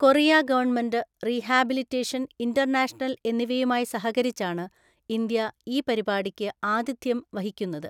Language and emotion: Malayalam, neutral